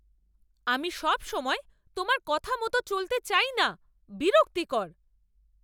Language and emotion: Bengali, angry